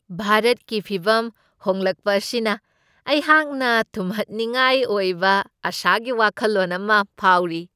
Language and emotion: Manipuri, happy